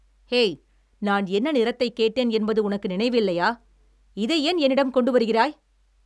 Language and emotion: Tamil, angry